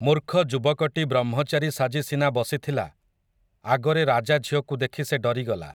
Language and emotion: Odia, neutral